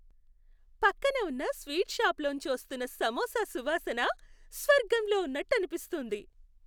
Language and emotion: Telugu, happy